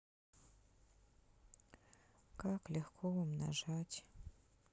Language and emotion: Russian, sad